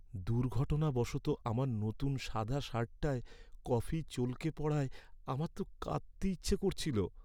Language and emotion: Bengali, sad